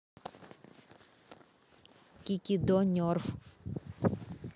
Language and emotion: Russian, neutral